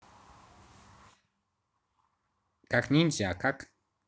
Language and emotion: Russian, neutral